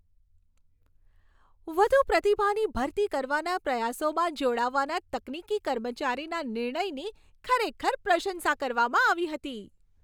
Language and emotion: Gujarati, happy